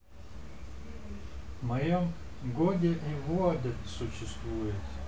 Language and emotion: Russian, neutral